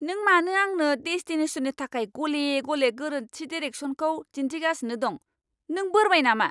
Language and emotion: Bodo, angry